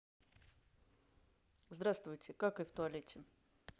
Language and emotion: Russian, neutral